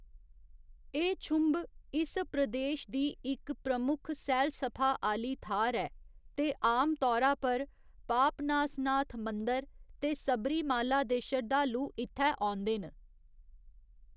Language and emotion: Dogri, neutral